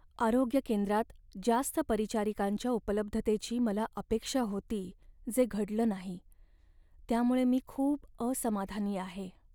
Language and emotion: Marathi, sad